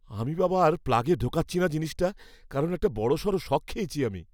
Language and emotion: Bengali, fearful